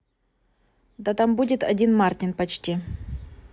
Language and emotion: Russian, neutral